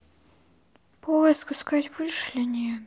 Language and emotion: Russian, sad